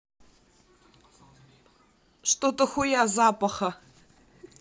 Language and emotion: Russian, neutral